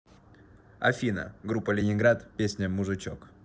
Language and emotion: Russian, neutral